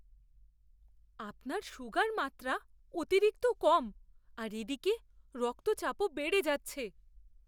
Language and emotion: Bengali, fearful